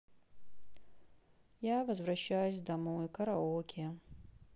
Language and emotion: Russian, sad